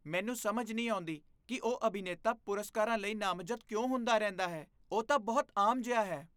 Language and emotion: Punjabi, disgusted